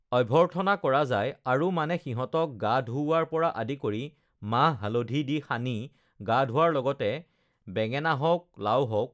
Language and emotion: Assamese, neutral